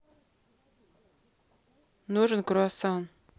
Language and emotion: Russian, neutral